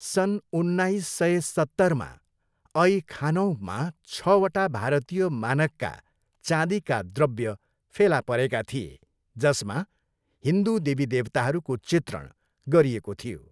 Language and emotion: Nepali, neutral